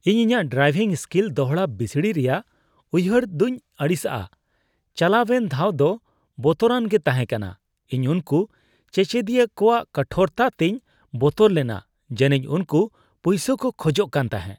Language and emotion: Santali, disgusted